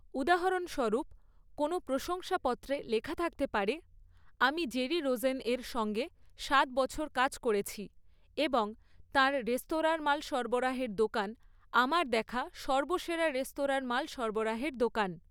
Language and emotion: Bengali, neutral